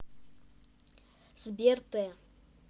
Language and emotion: Russian, neutral